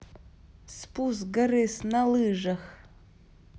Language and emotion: Russian, neutral